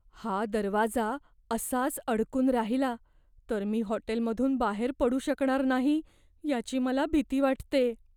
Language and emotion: Marathi, fearful